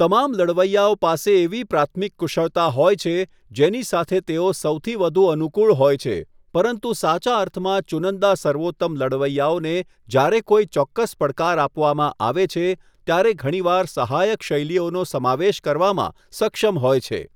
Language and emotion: Gujarati, neutral